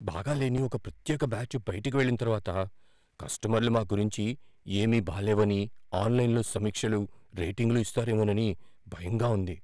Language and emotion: Telugu, fearful